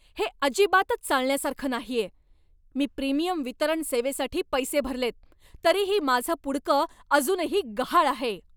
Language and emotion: Marathi, angry